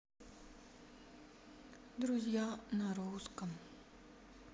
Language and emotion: Russian, sad